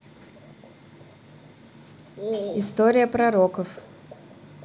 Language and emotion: Russian, neutral